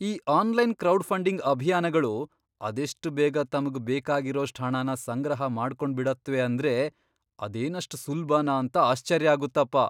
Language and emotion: Kannada, surprised